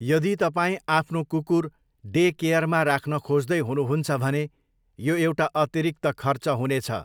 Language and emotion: Nepali, neutral